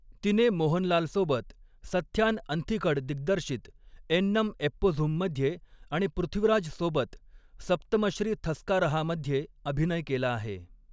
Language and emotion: Marathi, neutral